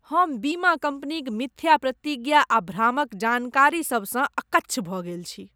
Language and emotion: Maithili, disgusted